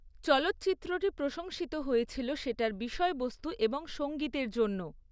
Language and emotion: Bengali, neutral